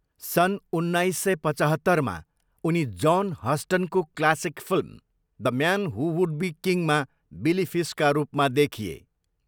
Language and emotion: Nepali, neutral